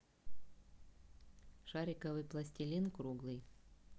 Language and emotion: Russian, neutral